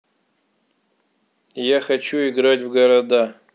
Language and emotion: Russian, neutral